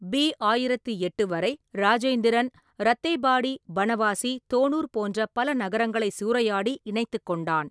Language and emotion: Tamil, neutral